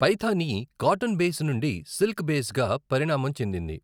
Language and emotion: Telugu, neutral